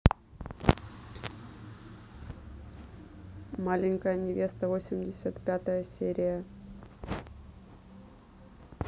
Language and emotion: Russian, neutral